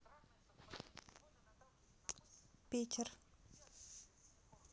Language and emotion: Russian, neutral